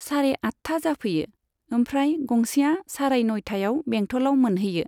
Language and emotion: Bodo, neutral